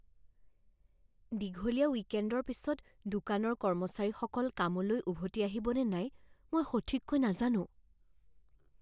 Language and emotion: Assamese, fearful